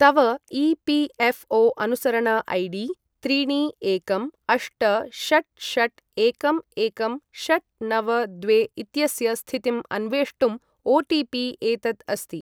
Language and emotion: Sanskrit, neutral